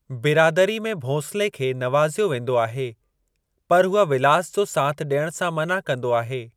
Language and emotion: Sindhi, neutral